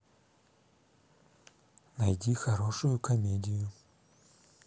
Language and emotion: Russian, neutral